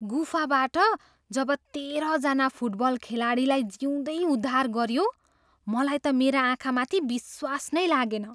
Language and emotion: Nepali, surprised